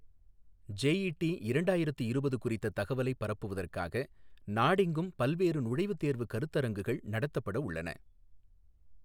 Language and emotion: Tamil, neutral